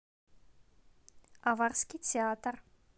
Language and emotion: Russian, neutral